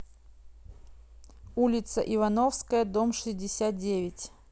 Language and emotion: Russian, neutral